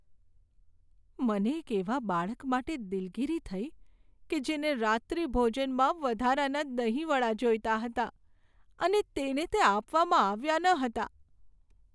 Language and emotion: Gujarati, sad